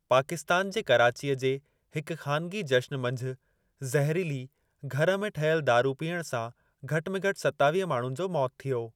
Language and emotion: Sindhi, neutral